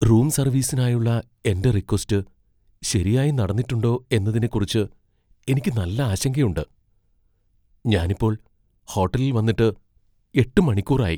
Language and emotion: Malayalam, fearful